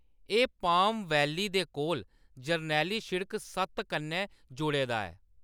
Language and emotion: Dogri, neutral